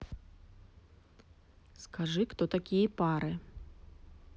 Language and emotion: Russian, neutral